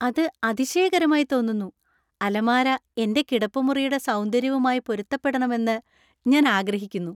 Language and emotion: Malayalam, happy